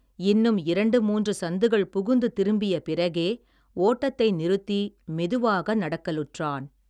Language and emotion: Tamil, neutral